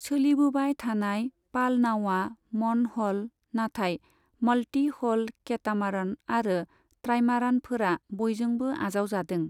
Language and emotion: Bodo, neutral